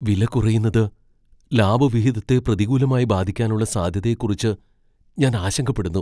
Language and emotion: Malayalam, fearful